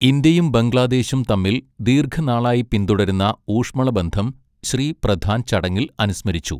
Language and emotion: Malayalam, neutral